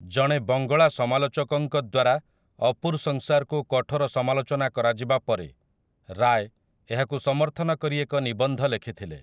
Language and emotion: Odia, neutral